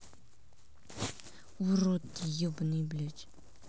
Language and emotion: Russian, angry